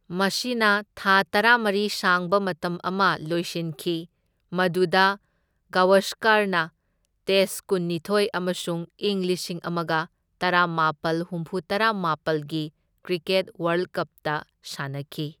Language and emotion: Manipuri, neutral